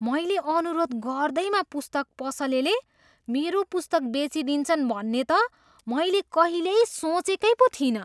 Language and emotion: Nepali, surprised